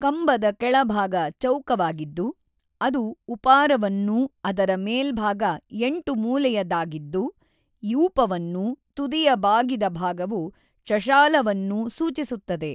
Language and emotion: Kannada, neutral